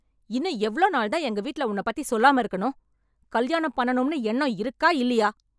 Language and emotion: Tamil, angry